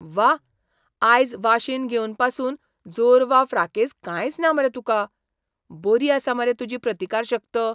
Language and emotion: Goan Konkani, surprised